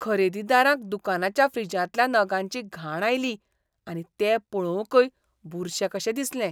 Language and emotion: Goan Konkani, disgusted